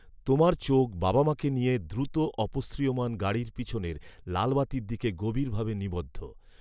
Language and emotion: Bengali, neutral